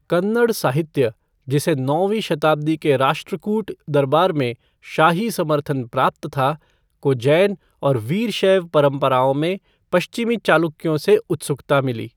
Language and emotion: Hindi, neutral